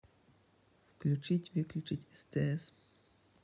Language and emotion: Russian, neutral